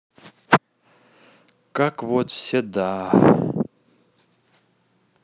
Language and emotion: Russian, sad